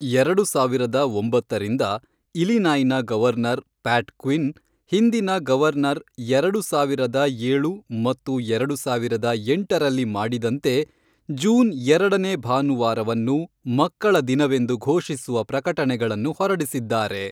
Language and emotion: Kannada, neutral